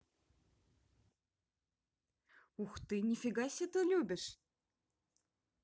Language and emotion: Russian, positive